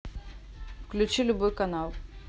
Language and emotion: Russian, neutral